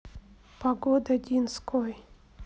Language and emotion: Russian, sad